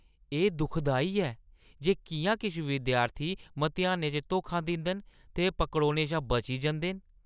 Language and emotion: Dogri, disgusted